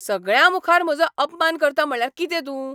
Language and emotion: Goan Konkani, angry